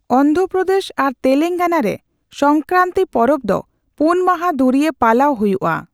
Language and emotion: Santali, neutral